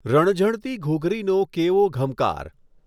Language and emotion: Gujarati, neutral